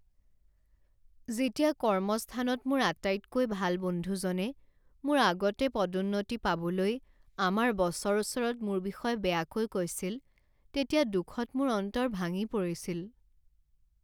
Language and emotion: Assamese, sad